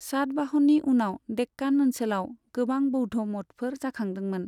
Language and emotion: Bodo, neutral